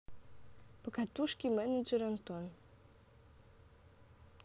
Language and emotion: Russian, neutral